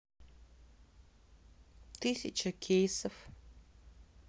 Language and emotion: Russian, sad